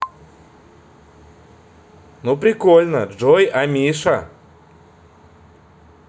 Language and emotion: Russian, positive